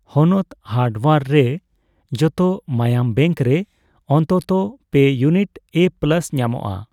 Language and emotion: Santali, neutral